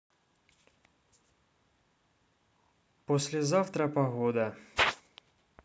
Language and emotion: Russian, neutral